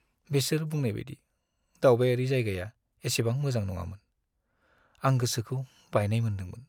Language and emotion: Bodo, sad